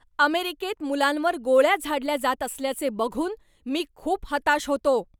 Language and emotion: Marathi, angry